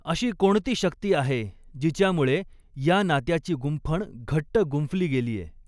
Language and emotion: Marathi, neutral